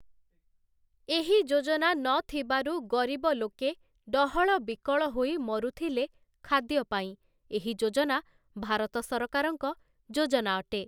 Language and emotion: Odia, neutral